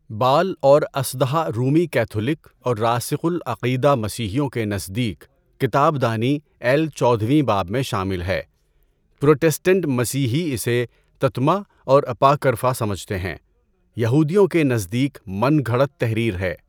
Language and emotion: Urdu, neutral